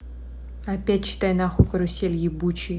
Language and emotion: Russian, angry